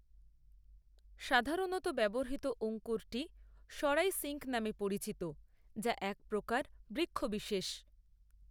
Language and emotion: Bengali, neutral